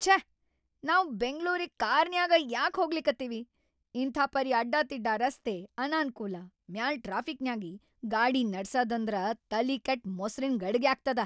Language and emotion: Kannada, angry